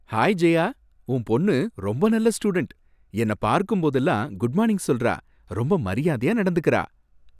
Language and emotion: Tamil, happy